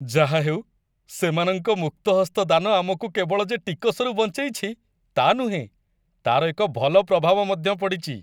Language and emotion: Odia, happy